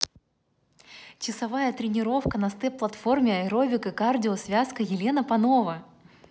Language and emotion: Russian, positive